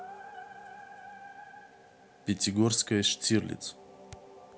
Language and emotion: Russian, neutral